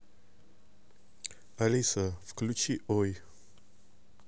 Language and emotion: Russian, neutral